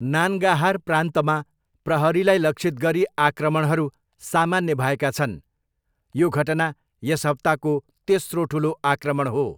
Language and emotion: Nepali, neutral